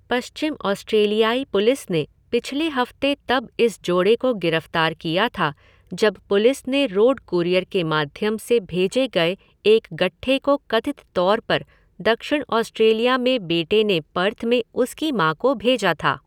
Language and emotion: Hindi, neutral